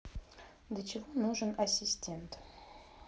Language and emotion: Russian, neutral